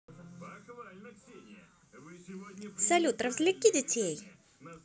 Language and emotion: Russian, positive